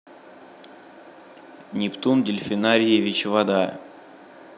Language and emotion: Russian, neutral